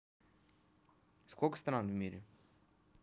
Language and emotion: Russian, neutral